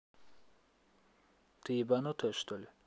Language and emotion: Russian, angry